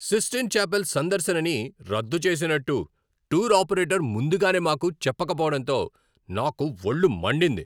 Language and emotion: Telugu, angry